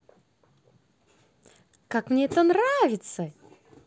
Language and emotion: Russian, positive